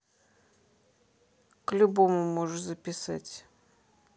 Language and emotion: Russian, neutral